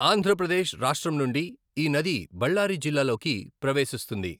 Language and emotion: Telugu, neutral